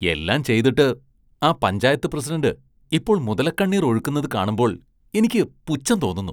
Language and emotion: Malayalam, disgusted